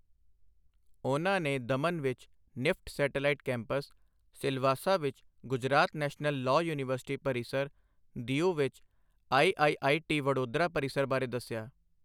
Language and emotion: Punjabi, neutral